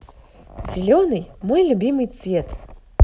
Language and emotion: Russian, positive